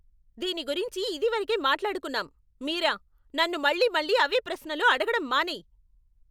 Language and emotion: Telugu, angry